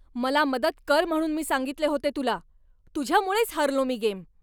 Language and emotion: Marathi, angry